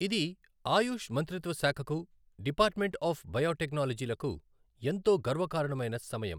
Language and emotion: Telugu, neutral